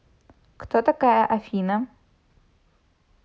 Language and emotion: Russian, neutral